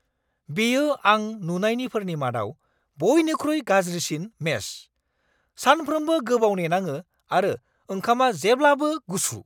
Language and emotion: Bodo, angry